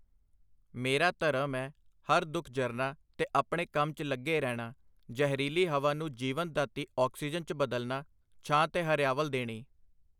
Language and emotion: Punjabi, neutral